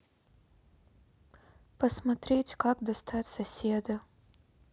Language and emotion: Russian, sad